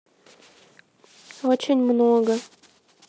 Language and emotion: Russian, neutral